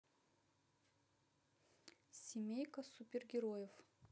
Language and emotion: Russian, neutral